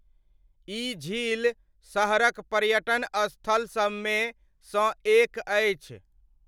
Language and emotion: Maithili, neutral